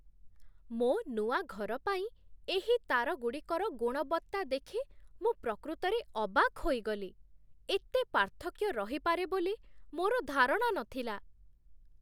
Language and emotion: Odia, surprised